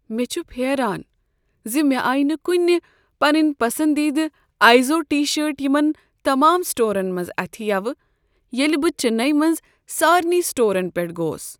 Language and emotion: Kashmiri, sad